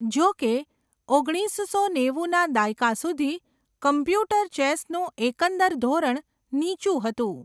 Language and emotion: Gujarati, neutral